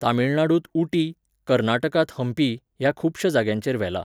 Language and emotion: Goan Konkani, neutral